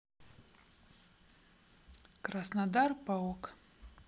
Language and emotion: Russian, neutral